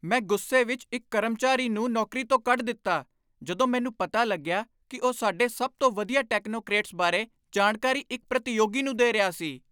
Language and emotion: Punjabi, angry